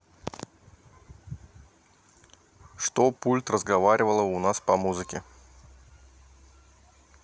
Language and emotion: Russian, neutral